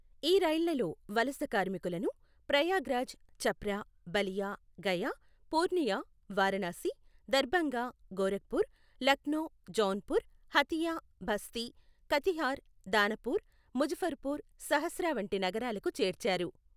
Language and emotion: Telugu, neutral